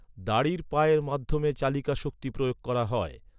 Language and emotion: Bengali, neutral